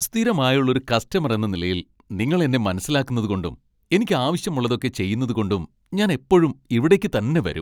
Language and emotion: Malayalam, happy